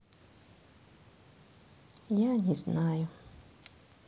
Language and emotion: Russian, sad